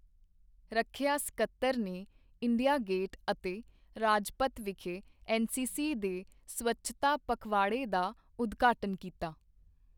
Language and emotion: Punjabi, neutral